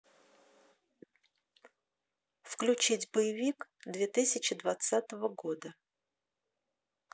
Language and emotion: Russian, neutral